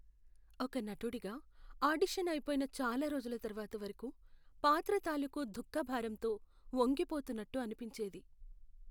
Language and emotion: Telugu, sad